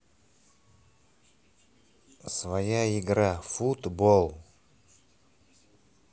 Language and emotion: Russian, neutral